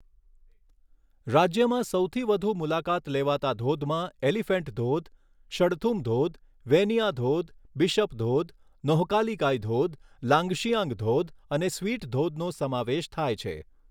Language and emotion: Gujarati, neutral